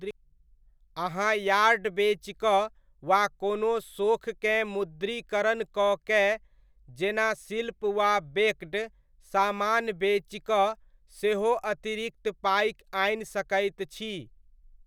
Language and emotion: Maithili, neutral